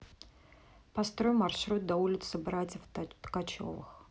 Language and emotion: Russian, neutral